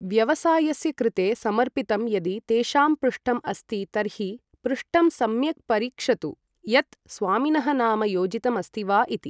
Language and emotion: Sanskrit, neutral